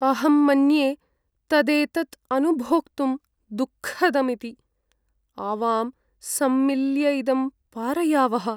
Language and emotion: Sanskrit, sad